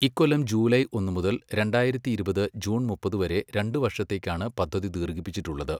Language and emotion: Malayalam, neutral